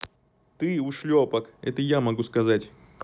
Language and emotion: Russian, neutral